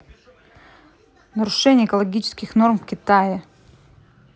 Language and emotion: Russian, neutral